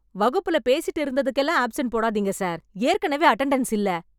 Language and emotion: Tamil, angry